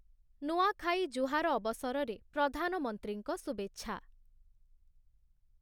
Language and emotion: Odia, neutral